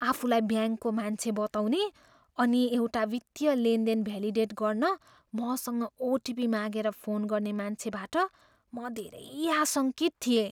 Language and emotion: Nepali, fearful